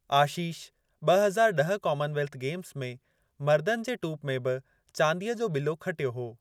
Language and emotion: Sindhi, neutral